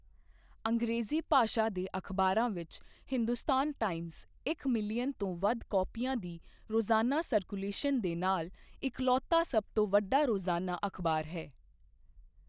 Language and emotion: Punjabi, neutral